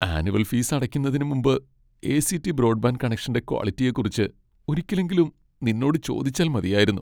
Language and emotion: Malayalam, sad